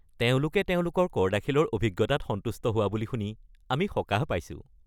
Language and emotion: Assamese, happy